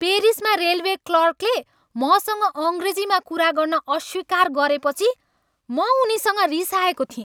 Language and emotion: Nepali, angry